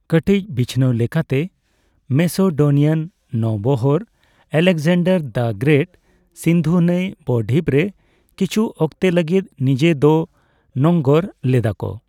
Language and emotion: Santali, neutral